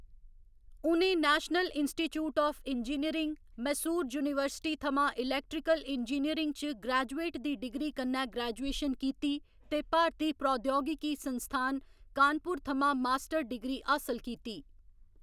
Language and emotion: Dogri, neutral